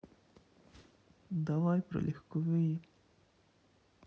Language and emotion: Russian, sad